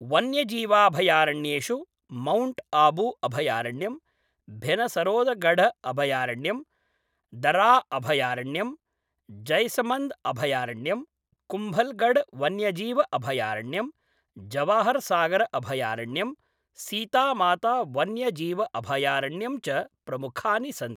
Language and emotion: Sanskrit, neutral